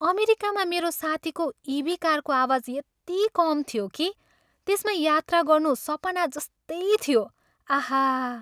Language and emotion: Nepali, happy